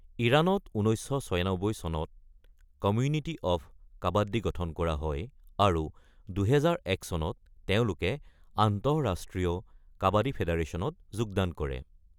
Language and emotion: Assamese, neutral